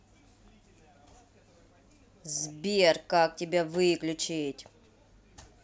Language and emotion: Russian, angry